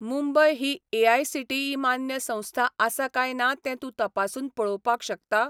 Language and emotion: Goan Konkani, neutral